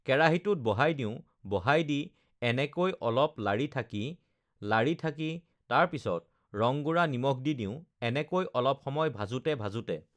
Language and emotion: Assamese, neutral